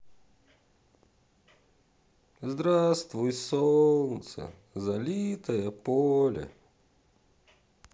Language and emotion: Russian, sad